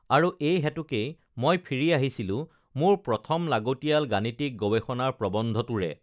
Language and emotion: Assamese, neutral